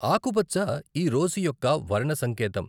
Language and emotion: Telugu, neutral